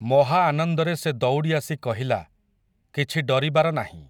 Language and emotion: Odia, neutral